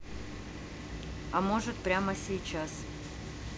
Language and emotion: Russian, neutral